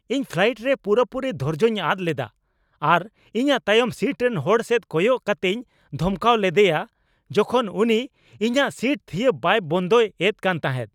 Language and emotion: Santali, angry